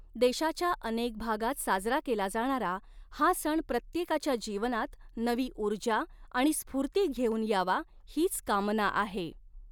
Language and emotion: Marathi, neutral